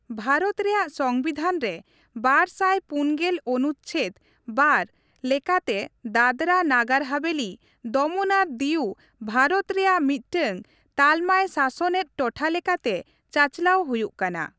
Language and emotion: Santali, neutral